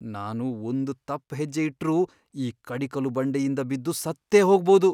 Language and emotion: Kannada, fearful